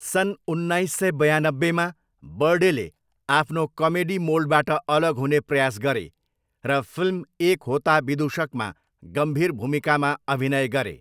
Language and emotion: Nepali, neutral